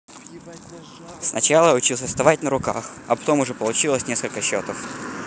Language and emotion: Russian, neutral